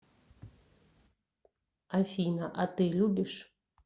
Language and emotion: Russian, neutral